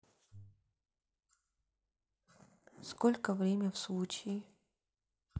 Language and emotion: Russian, sad